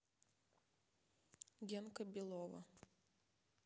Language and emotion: Russian, neutral